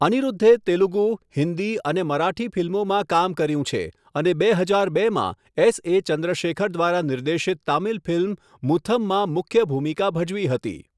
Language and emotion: Gujarati, neutral